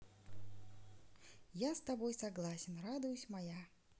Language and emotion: Russian, positive